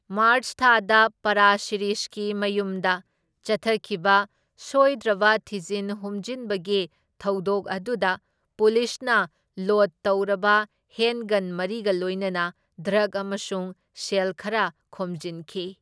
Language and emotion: Manipuri, neutral